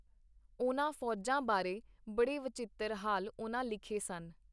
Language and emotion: Punjabi, neutral